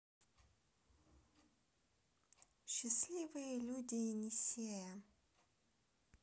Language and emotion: Russian, neutral